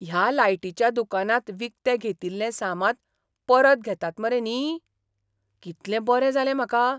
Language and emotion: Goan Konkani, surprised